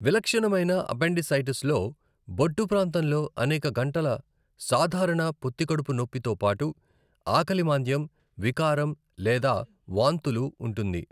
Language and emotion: Telugu, neutral